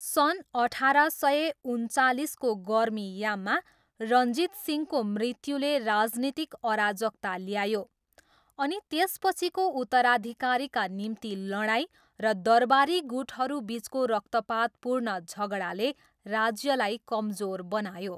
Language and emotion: Nepali, neutral